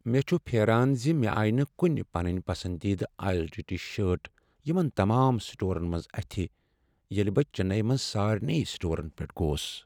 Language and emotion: Kashmiri, sad